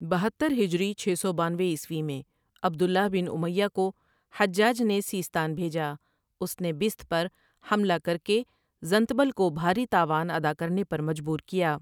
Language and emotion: Urdu, neutral